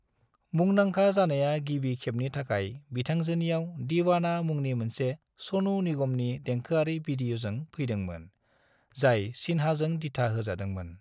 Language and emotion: Bodo, neutral